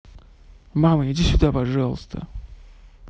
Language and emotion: Russian, neutral